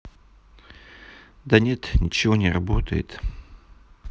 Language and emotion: Russian, sad